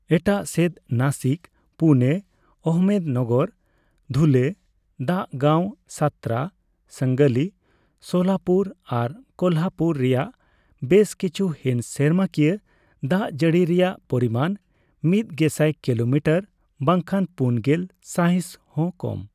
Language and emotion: Santali, neutral